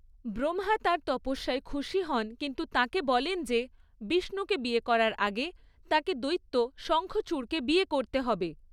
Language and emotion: Bengali, neutral